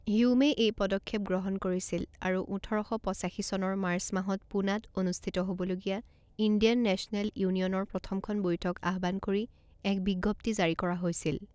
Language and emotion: Assamese, neutral